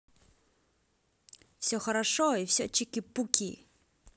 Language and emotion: Russian, positive